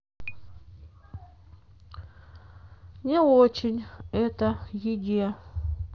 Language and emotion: Russian, sad